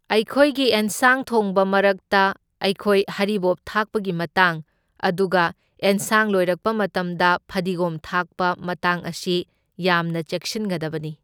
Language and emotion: Manipuri, neutral